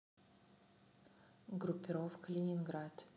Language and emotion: Russian, neutral